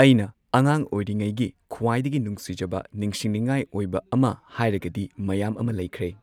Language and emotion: Manipuri, neutral